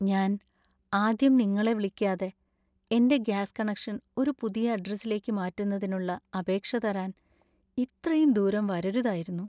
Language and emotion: Malayalam, sad